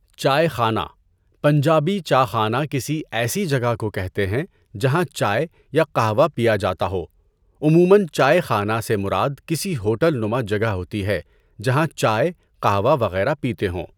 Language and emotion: Urdu, neutral